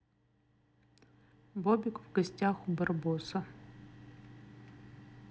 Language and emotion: Russian, neutral